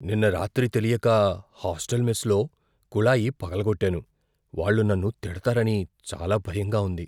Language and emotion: Telugu, fearful